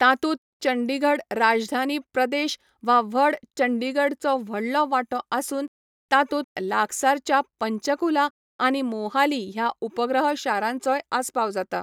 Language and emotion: Goan Konkani, neutral